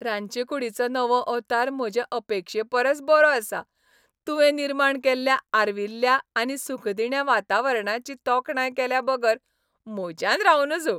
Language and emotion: Goan Konkani, happy